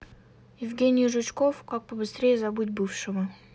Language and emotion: Russian, neutral